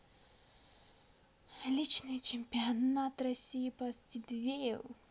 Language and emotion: Russian, positive